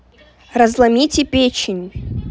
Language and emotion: Russian, neutral